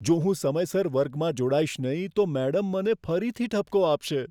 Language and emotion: Gujarati, fearful